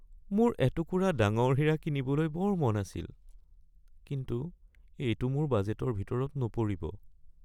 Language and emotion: Assamese, sad